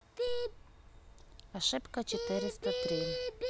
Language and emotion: Russian, neutral